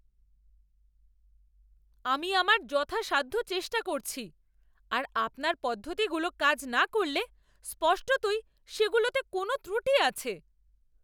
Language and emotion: Bengali, angry